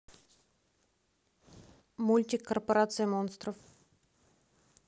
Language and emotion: Russian, neutral